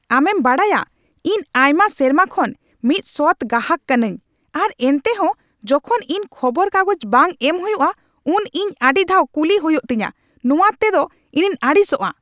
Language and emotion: Santali, angry